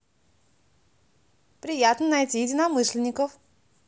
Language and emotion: Russian, positive